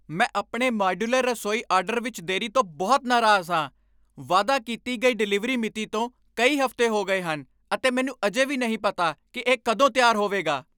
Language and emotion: Punjabi, angry